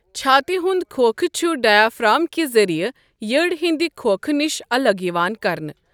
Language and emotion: Kashmiri, neutral